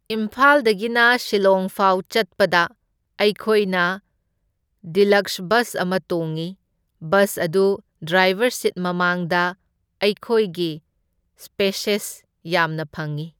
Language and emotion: Manipuri, neutral